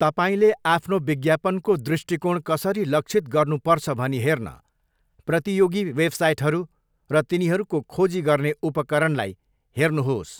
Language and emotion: Nepali, neutral